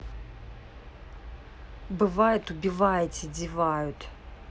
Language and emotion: Russian, angry